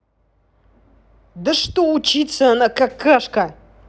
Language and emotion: Russian, angry